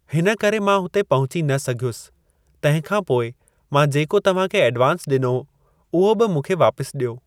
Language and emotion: Sindhi, neutral